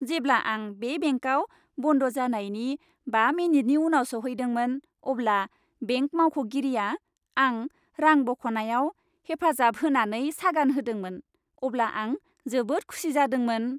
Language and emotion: Bodo, happy